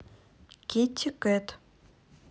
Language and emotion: Russian, neutral